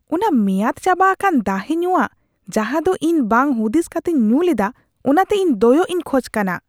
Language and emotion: Santali, disgusted